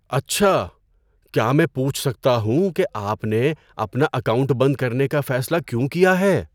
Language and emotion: Urdu, surprised